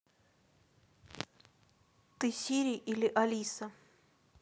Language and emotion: Russian, neutral